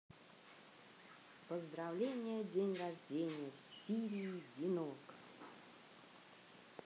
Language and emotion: Russian, positive